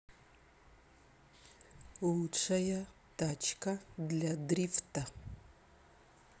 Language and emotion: Russian, neutral